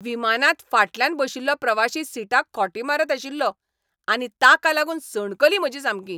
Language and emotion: Goan Konkani, angry